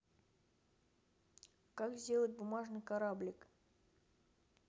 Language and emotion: Russian, neutral